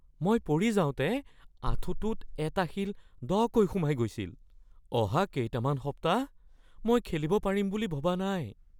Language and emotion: Assamese, fearful